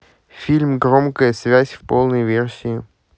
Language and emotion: Russian, neutral